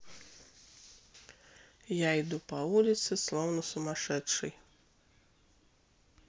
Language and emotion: Russian, neutral